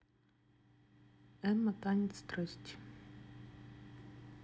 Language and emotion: Russian, neutral